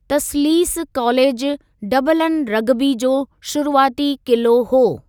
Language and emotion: Sindhi, neutral